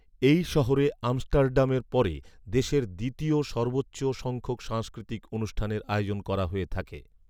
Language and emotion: Bengali, neutral